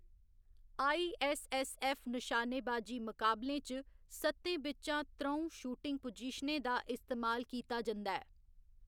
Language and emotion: Dogri, neutral